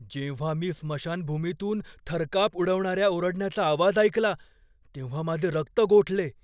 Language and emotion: Marathi, fearful